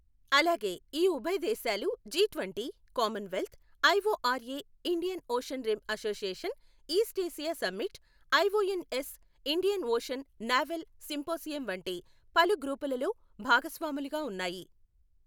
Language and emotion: Telugu, neutral